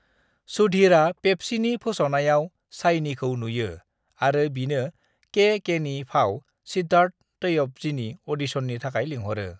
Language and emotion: Bodo, neutral